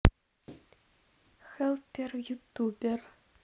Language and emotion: Russian, neutral